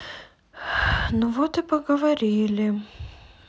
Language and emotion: Russian, sad